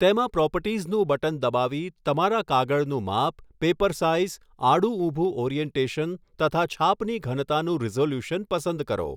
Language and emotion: Gujarati, neutral